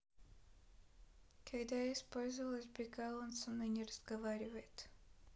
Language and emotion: Russian, neutral